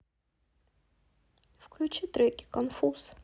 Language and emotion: Russian, sad